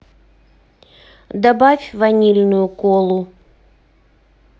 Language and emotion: Russian, neutral